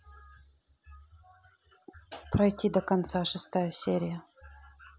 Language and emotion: Russian, neutral